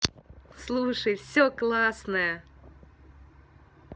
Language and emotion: Russian, positive